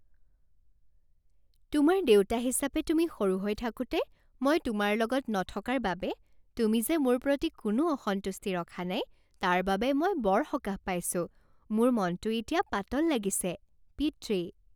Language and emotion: Assamese, happy